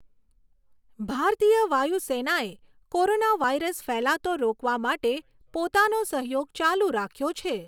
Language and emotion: Gujarati, neutral